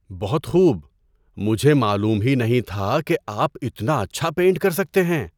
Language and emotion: Urdu, surprised